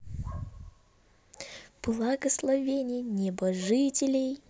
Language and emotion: Russian, positive